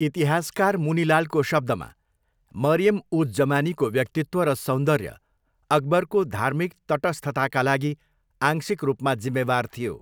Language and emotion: Nepali, neutral